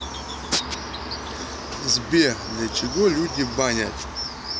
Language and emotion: Russian, neutral